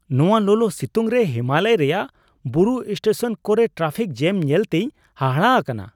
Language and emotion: Santali, surprised